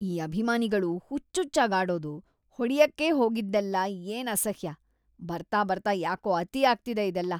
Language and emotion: Kannada, disgusted